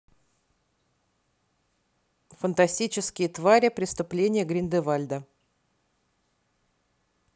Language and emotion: Russian, neutral